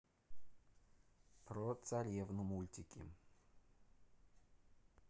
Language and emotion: Russian, neutral